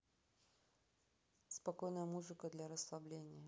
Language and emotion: Russian, neutral